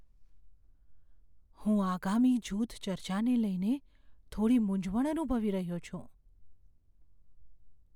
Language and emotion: Gujarati, fearful